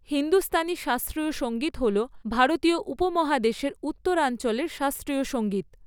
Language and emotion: Bengali, neutral